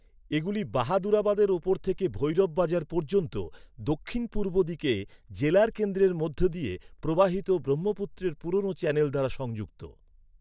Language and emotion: Bengali, neutral